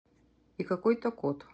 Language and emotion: Russian, neutral